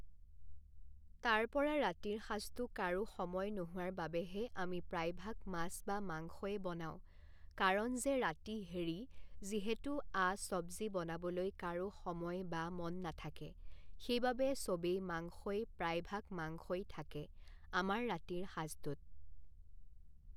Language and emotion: Assamese, neutral